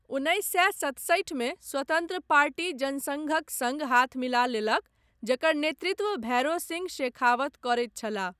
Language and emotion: Maithili, neutral